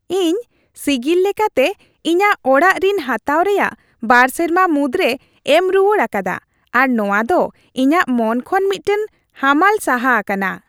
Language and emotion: Santali, happy